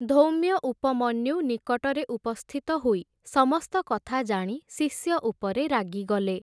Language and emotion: Odia, neutral